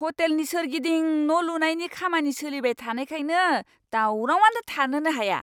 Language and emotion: Bodo, angry